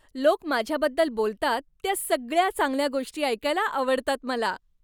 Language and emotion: Marathi, happy